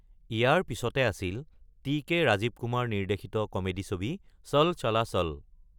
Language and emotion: Assamese, neutral